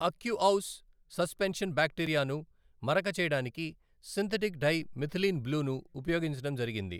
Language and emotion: Telugu, neutral